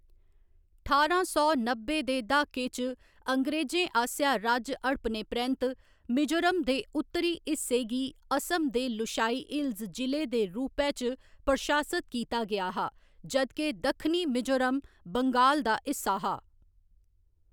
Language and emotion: Dogri, neutral